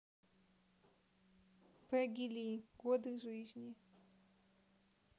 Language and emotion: Russian, neutral